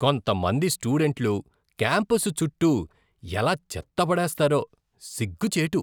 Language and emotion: Telugu, disgusted